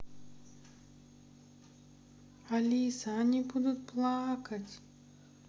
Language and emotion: Russian, sad